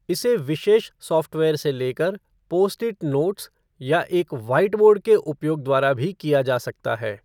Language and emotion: Hindi, neutral